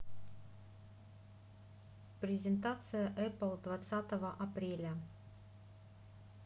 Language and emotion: Russian, neutral